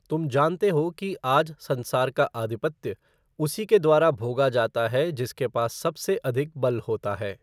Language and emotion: Hindi, neutral